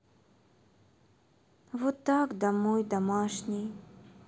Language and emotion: Russian, sad